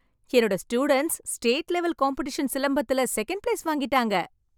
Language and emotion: Tamil, happy